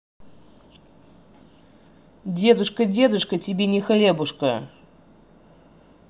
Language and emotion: Russian, angry